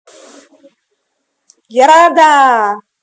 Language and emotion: Russian, positive